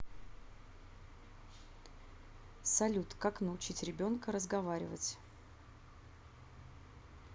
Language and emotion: Russian, neutral